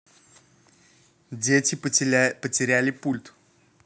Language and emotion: Russian, neutral